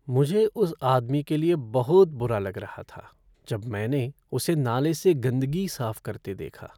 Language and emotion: Hindi, sad